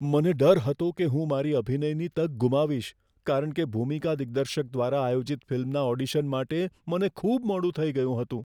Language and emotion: Gujarati, fearful